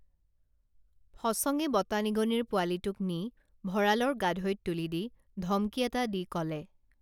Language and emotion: Assamese, neutral